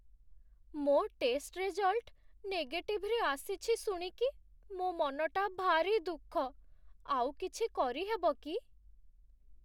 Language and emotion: Odia, sad